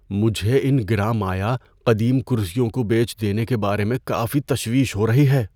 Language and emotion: Urdu, fearful